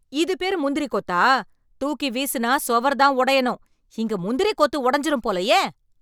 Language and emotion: Tamil, angry